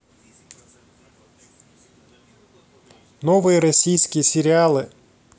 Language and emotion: Russian, neutral